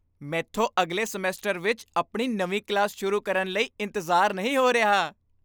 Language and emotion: Punjabi, happy